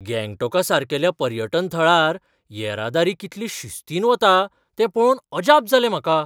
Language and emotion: Goan Konkani, surprised